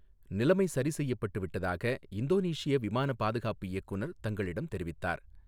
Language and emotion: Tamil, neutral